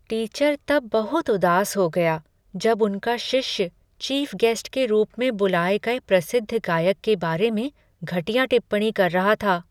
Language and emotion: Hindi, sad